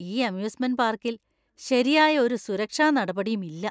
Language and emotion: Malayalam, disgusted